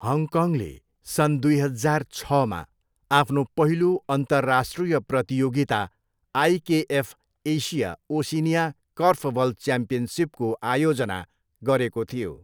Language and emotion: Nepali, neutral